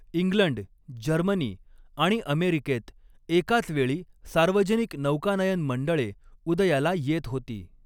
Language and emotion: Marathi, neutral